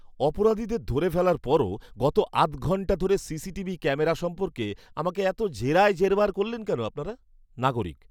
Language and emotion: Bengali, angry